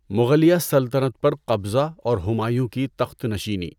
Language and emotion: Urdu, neutral